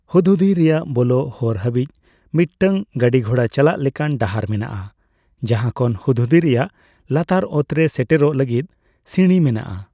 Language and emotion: Santali, neutral